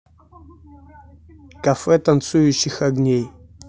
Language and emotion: Russian, neutral